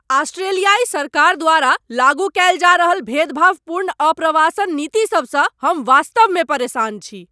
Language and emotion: Maithili, angry